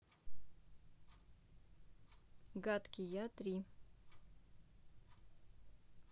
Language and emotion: Russian, neutral